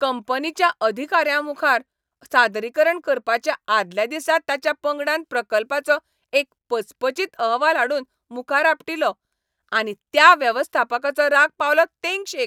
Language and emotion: Goan Konkani, angry